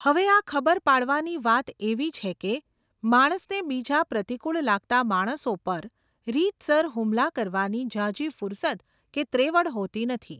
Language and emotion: Gujarati, neutral